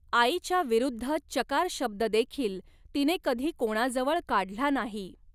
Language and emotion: Marathi, neutral